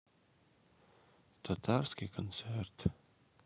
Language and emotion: Russian, sad